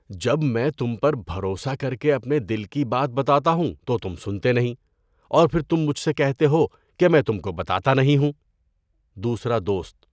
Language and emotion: Urdu, disgusted